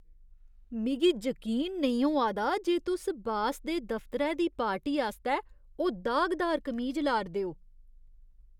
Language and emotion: Dogri, disgusted